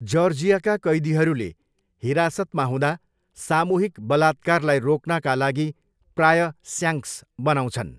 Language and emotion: Nepali, neutral